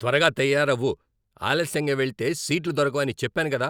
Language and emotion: Telugu, angry